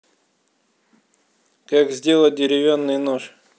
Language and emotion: Russian, neutral